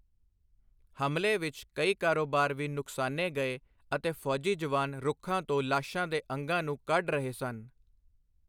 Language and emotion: Punjabi, neutral